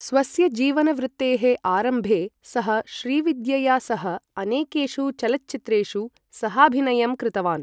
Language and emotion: Sanskrit, neutral